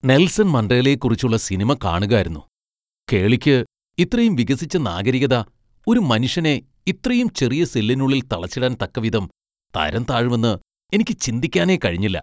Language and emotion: Malayalam, disgusted